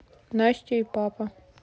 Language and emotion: Russian, neutral